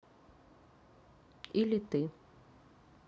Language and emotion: Russian, neutral